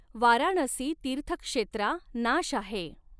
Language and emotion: Marathi, neutral